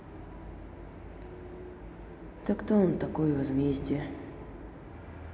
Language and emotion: Russian, sad